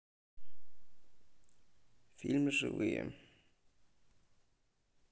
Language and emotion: Russian, neutral